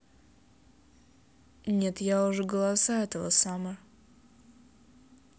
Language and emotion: Russian, neutral